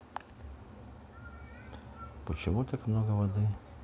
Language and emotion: Russian, neutral